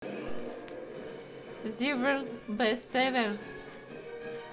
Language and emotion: Russian, neutral